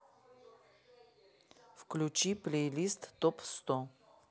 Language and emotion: Russian, neutral